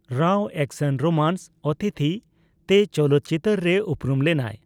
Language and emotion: Santali, neutral